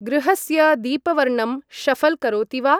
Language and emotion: Sanskrit, neutral